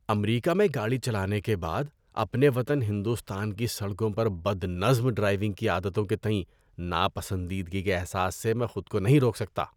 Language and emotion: Urdu, disgusted